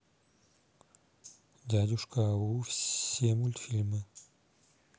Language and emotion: Russian, neutral